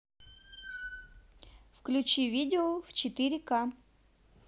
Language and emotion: Russian, neutral